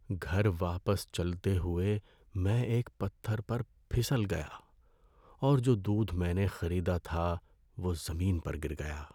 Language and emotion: Urdu, sad